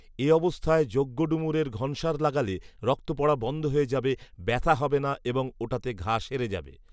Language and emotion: Bengali, neutral